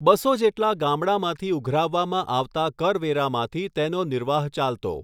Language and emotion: Gujarati, neutral